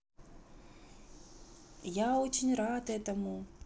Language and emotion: Russian, positive